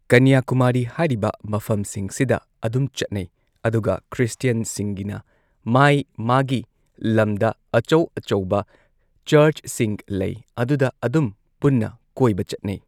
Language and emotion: Manipuri, neutral